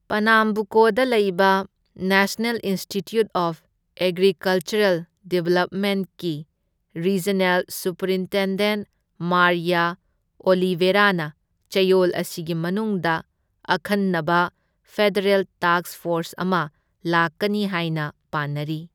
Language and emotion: Manipuri, neutral